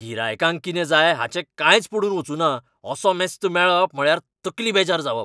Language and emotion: Goan Konkani, angry